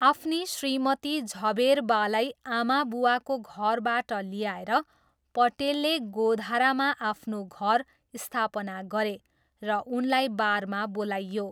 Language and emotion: Nepali, neutral